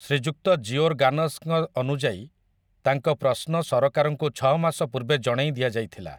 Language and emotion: Odia, neutral